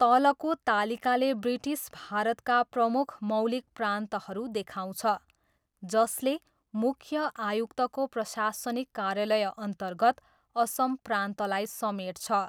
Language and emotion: Nepali, neutral